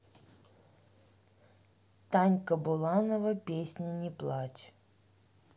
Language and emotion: Russian, neutral